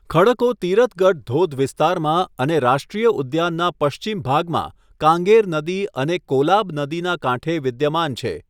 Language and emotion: Gujarati, neutral